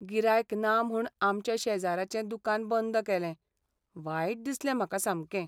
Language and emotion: Goan Konkani, sad